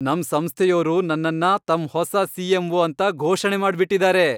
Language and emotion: Kannada, happy